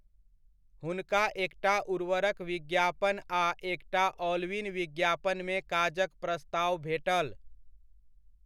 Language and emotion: Maithili, neutral